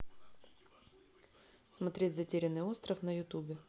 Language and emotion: Russian, neutral